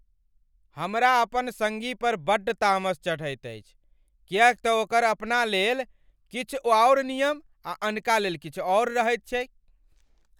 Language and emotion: Maithili, angry